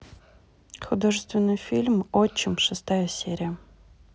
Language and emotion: Russian, neutral